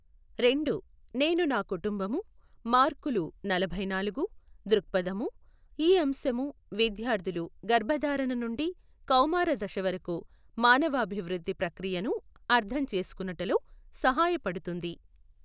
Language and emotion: Telugu, neutral